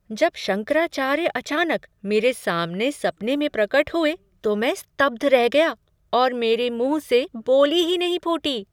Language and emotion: Hindi, surprised